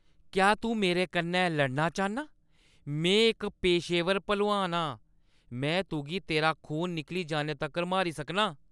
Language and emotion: Dogri, angry